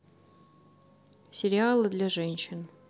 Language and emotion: Russian, neutral